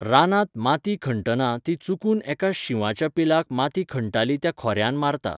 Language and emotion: Goan Konkani, neutral